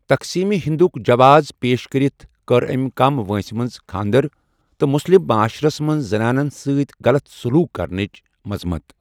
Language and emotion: Kashmiri, neutral